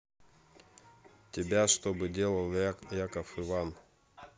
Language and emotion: Russian, neutral